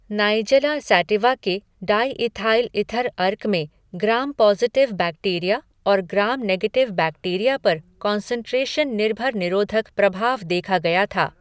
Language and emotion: Hindi, neutral